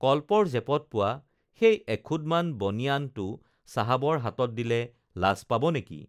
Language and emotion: Assamese, neutral